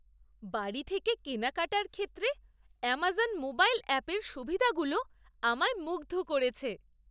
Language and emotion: Bengali, surprised